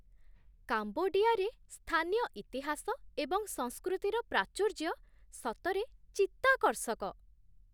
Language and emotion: Odia, surprised